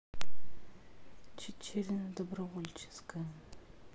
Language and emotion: Russian, neutral